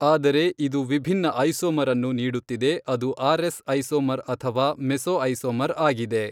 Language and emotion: Kannada, neutral